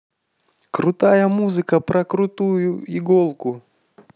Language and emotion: Russian, positive